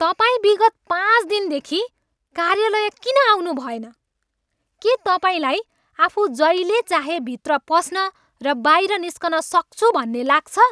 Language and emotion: Nepali, angry